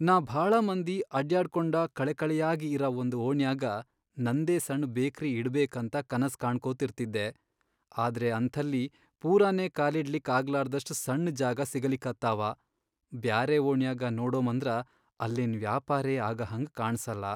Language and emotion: Kannada, sad